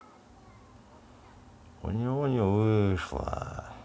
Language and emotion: Russian, sad